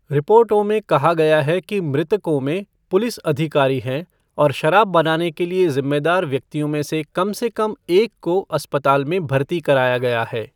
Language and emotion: Hindi, neutral